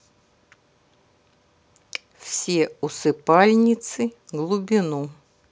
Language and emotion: Russian, neutral